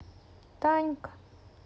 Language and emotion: Russian, sad